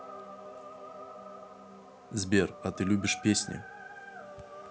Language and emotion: Russian, neutral